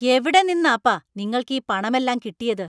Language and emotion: Malayalam, angry